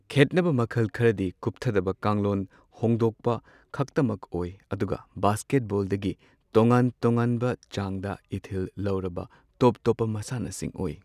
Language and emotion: Manipuri, neutral